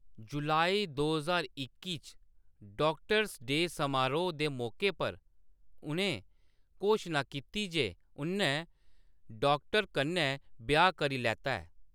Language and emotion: Dogri, neutral